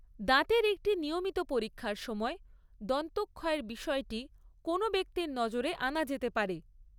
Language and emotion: Bengali, neutral